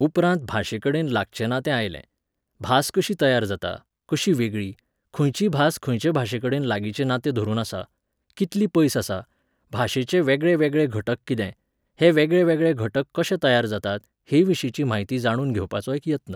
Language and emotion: Goan Konkani, neutral